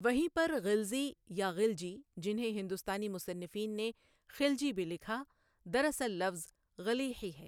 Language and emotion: Urdu, neutral